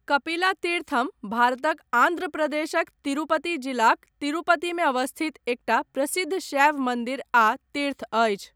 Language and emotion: Maithili, neutral